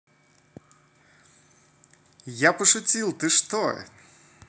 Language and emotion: Russian, positive